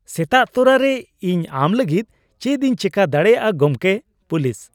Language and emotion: Santali, happy